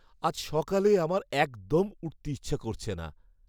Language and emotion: Bengali, sad